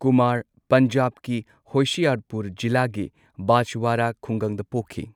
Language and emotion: Manipuri, neutral